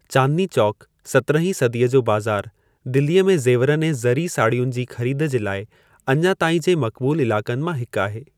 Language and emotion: Sindhi, neutral